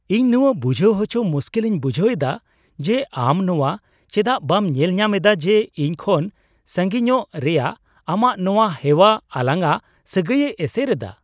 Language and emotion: Santali, surprised